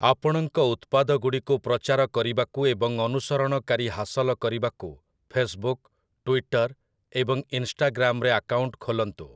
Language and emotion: Odia, neutral